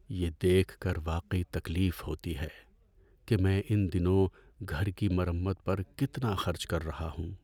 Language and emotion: Urdu, sad